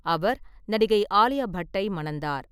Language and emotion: Tamil, neutral